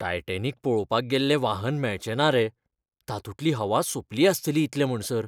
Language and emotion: Goan Konkani, fearful